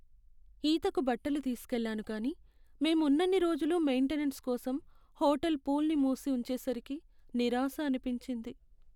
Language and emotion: Telugu, sad